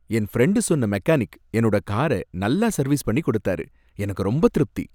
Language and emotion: Tamil, happy